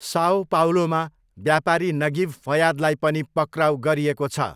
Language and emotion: Nepali, neutral